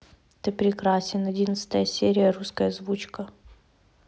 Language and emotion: Russian, neutral